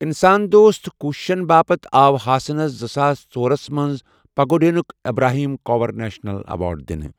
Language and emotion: Kashmiri, neutral